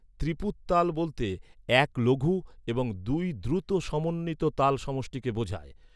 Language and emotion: Bengali, neutral